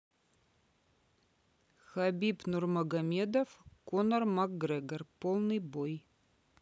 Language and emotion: Russian, neutral